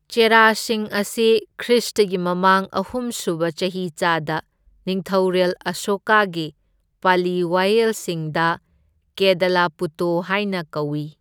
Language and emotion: Manipuri, neutral